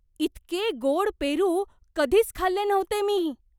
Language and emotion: Marathi, surprised